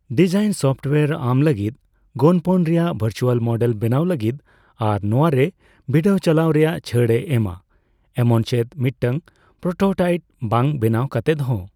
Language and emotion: Santali, neutral